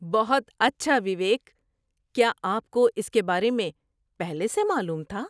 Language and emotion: Urdu, surprised